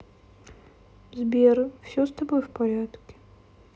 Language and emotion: Russian, sad